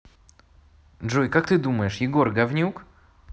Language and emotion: Russian, neutral